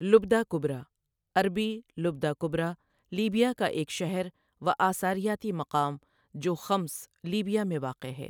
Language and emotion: Urdu, neutral